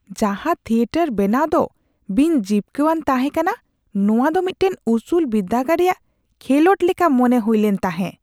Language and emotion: Santali, disgusted